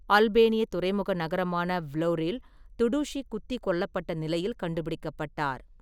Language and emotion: Tamil, neutral